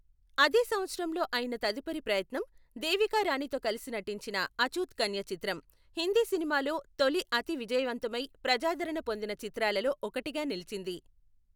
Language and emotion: Telugu, neutral